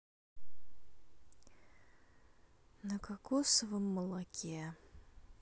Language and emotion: Russian, sad